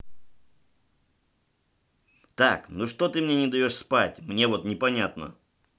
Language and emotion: Russian, angry